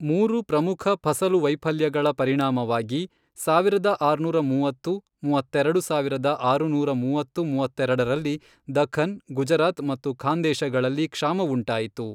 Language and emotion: Kannada, neutral